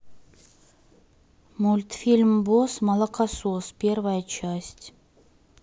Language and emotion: Russian, neutral